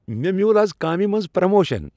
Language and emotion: Kashmiri, happy